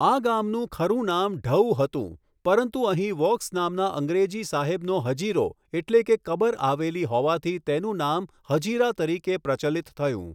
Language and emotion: Gujarati, neutral